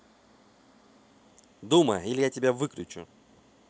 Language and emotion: Russian, angry